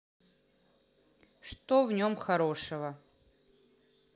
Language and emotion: Russian, neutral